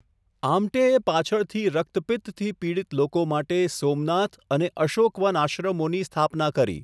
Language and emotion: Gujarati, neutral